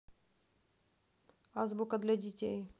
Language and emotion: Russian, neutral